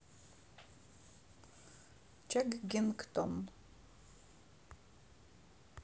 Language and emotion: Russian, neutral